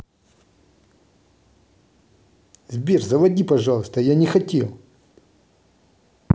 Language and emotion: Russian, angry